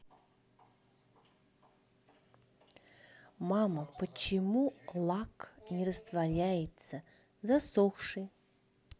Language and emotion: Russian, neutral